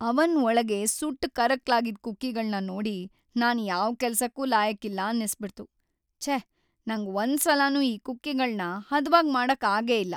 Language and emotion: Kannada, sad